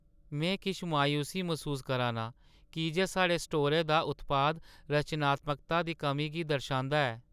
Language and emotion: Dogri, sad